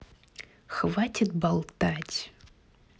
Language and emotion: Russian, angry